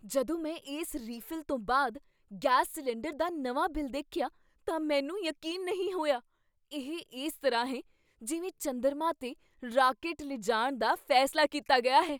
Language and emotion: Punjabi, surprised